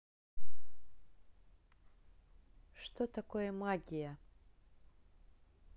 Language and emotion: Russian, neutral